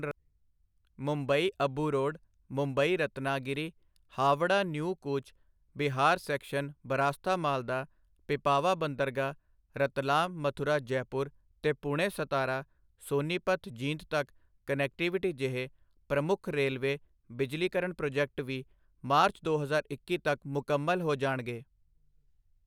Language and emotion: Punjabi, neutral